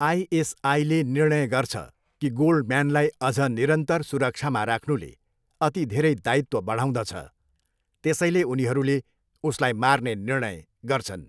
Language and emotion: Nepali, neutral